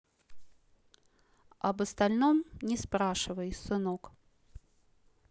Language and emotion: Russian, neutral